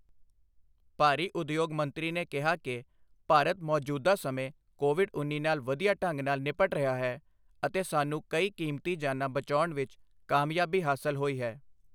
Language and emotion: Punjabi, neutral